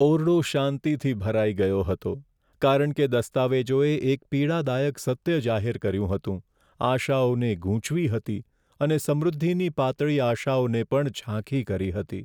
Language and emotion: Gujarati, sad